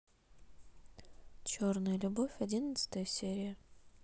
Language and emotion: Russian, neutral